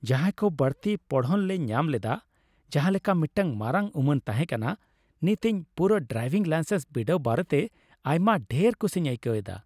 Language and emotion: Santali, happy